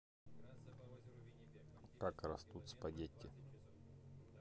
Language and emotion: Russian, neutral